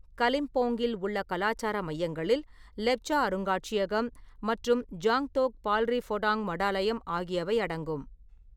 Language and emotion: Tamil, neutral